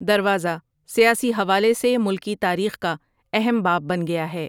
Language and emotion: Urdu, neutral